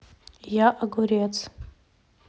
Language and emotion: Russian, neutral